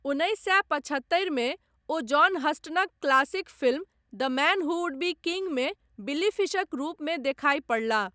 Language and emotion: Maithili, neutral